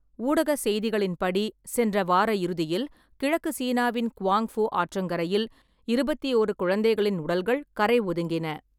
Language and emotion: Tamil, neutral